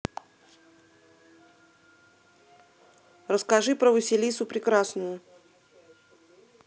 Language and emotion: Russian, neutral